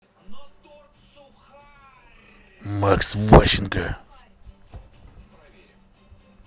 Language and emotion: Russian, angry